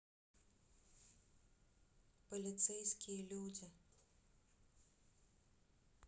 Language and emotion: Russian, neutral